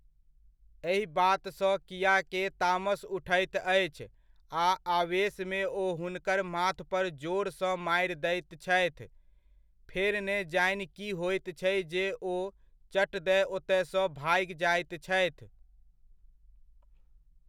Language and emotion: Maithili, neutral